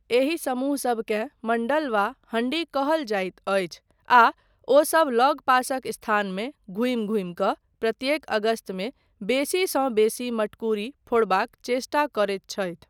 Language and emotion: Maithili, neutral